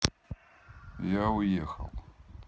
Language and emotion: Russian, neutral